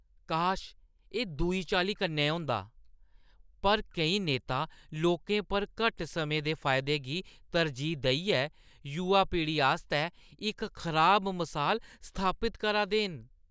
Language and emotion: Dogri, disgusted